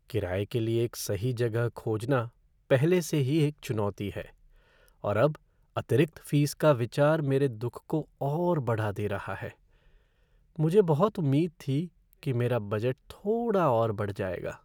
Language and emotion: Hindi, sad